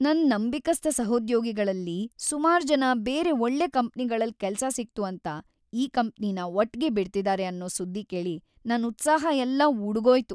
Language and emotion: Kannada, sad